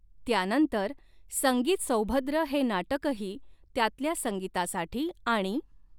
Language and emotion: Marathi, neutral